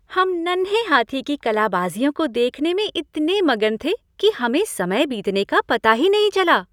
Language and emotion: Hindi, happy